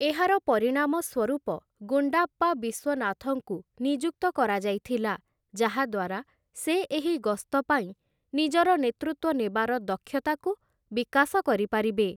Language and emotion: Odia, neutral